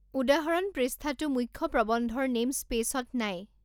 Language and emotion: Assamese, neutral